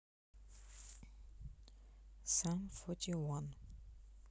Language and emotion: Russian, neutral